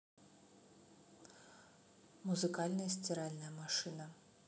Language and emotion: Russian, neutral